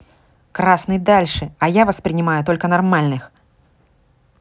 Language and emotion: Russian, angry